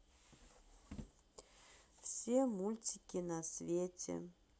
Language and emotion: Russian, neutral